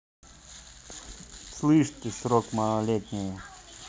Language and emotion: Russian, angry